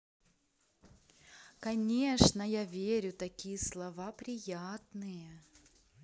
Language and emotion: Russian, positive